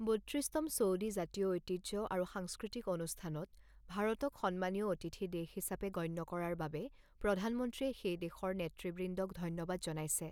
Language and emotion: Assamese, neutral